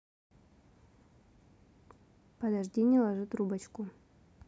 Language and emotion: Russian, neutral